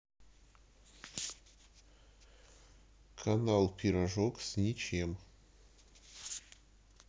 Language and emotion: Russian, neutral